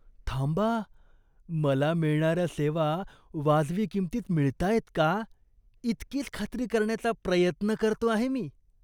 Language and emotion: Marathi, disgusted